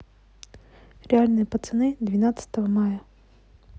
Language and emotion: Russian, neutral